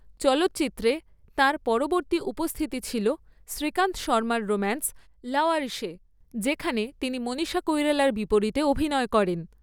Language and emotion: Bengali, neutral